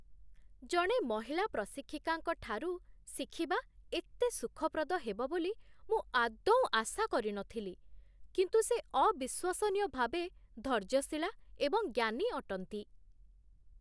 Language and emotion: Odia, surprised